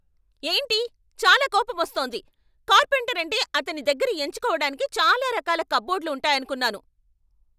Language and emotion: Telugu, angry